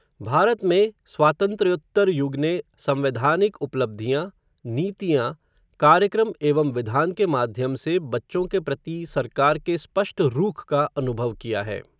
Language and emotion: Hindi, neutral